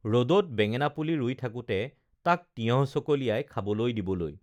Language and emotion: Assamese, neutral